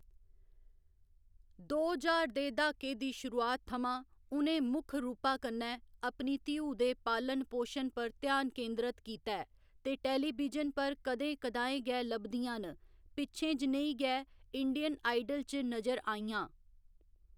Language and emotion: Dogri, neutral